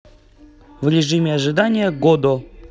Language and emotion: Russian, neutral